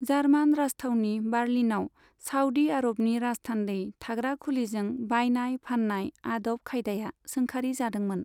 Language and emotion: Bodo, neutral